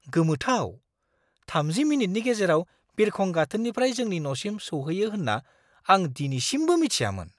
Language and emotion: Bodo, surprised